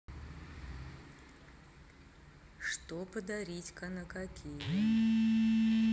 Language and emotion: Russian, neutral